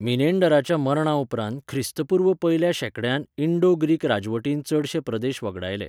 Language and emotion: Goan Konkani, neutral